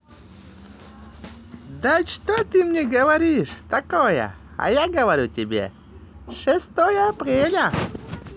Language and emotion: Russian, positive